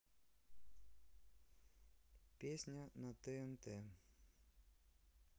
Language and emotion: Russian, neutral